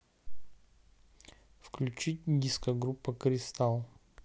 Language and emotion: Russian, neutral